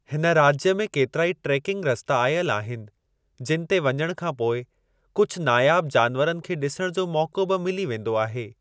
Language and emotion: Sindhi, neutral